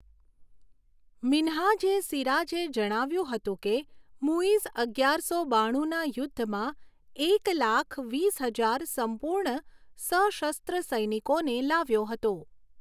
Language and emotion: Gujarati, neutral